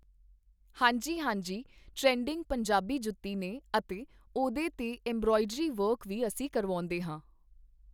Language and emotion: Punjabi, neutral